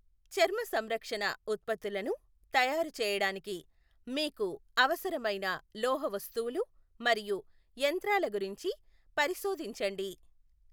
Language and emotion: Telugu, neutral